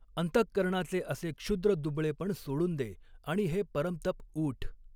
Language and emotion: Marathi, neutral